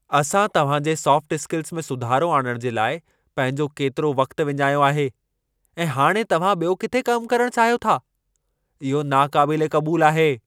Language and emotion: Sindhi, angry